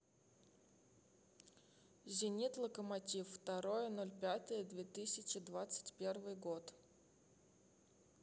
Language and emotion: Russian, neutral